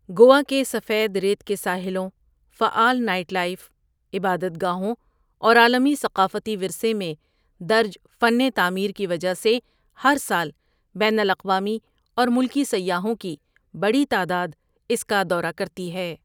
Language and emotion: Urdu, neutral